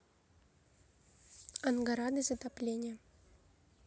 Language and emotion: Russian, neutral